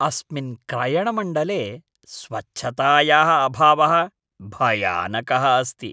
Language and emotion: Sanskrit, disgusted